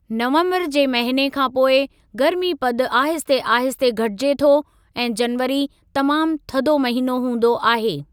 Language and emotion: Sindhi, neutral